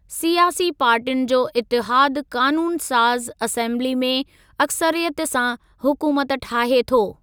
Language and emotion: Sindhi, neutral